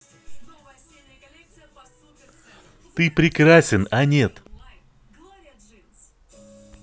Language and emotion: Russian, positive